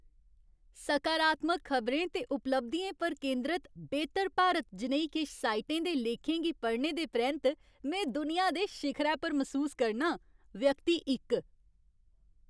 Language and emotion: Dogri, happy